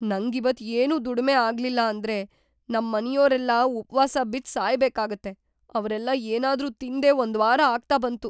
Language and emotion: Kannada, fearful